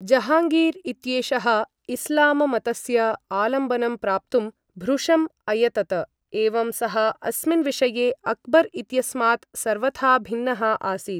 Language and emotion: Sanskrit, neutral